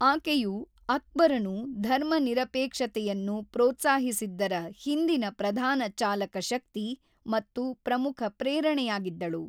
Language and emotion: Kannada, neutral